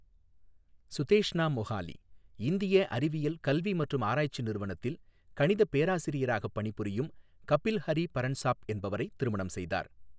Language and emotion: Tamil, neutral